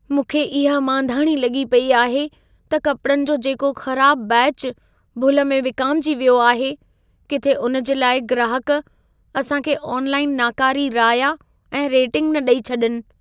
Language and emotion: Sindhi, fearful